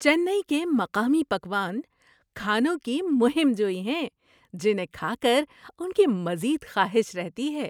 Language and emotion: Urdu, happy